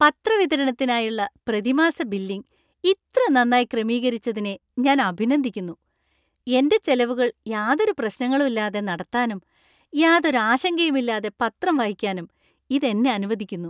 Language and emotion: Malayalam, happy